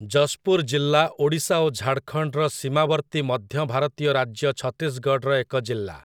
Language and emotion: Odia, neutral